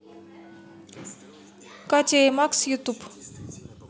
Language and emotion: Russian, neutral